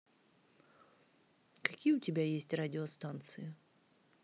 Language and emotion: Russian, neutral